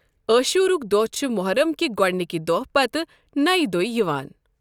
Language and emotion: Kashmiri, neutral